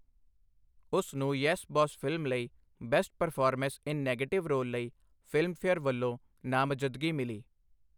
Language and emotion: Punjabi, neutral